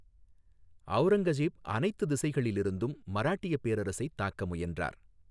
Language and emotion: Tamil, neutral